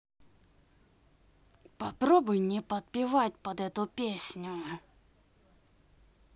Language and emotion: Russian, angry